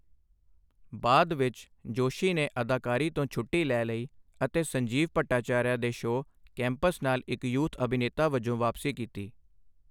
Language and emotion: Punjabi, neutral